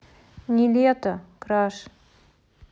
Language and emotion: Russian, neutral